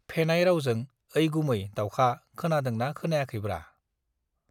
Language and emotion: Bodo, neutral